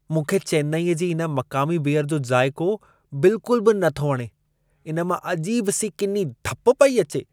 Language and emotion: Sindhi, disgusted